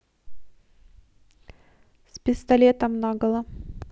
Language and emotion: Russian, neutral